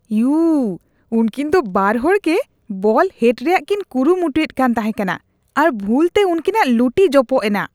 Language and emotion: Santali, disgusted